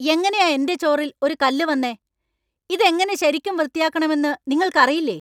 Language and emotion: Malayalam, angry